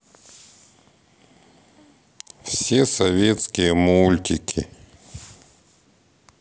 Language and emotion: Russian, sad